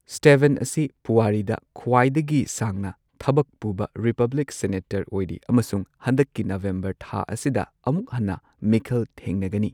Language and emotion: Manipuri, neutral